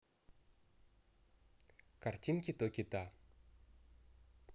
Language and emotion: Russian, neutral